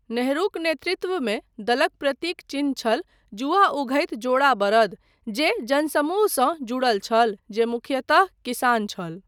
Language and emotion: Maithili, neutral